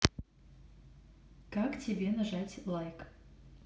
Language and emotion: Russian, neutral